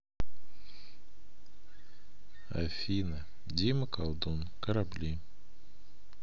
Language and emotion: Russian, neutral